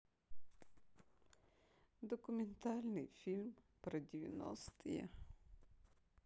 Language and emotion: Russian, sad